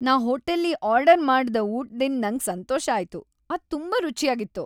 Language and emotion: Kannada, happy